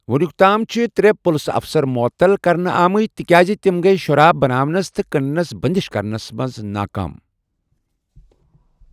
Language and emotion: Kashmiri, neutral